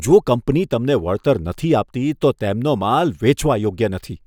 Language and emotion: Gujarati, disgusted